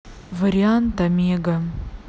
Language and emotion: Russian, neutral